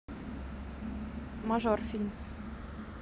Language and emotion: Russian, neutral